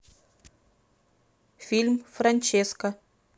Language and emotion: Russian, neutral